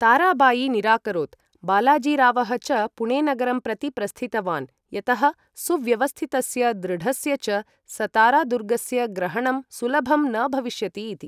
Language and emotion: Sanskrit, neutral